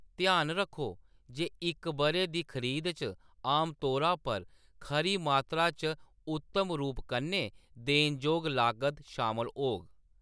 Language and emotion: Dogri, neutral